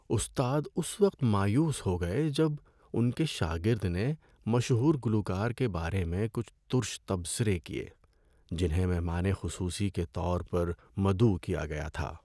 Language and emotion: Urdu, sad